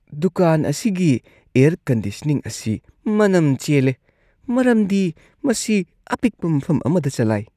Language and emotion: Manipuri, disgusted